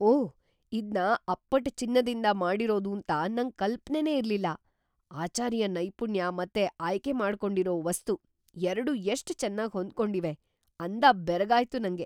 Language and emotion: Kannada, surprised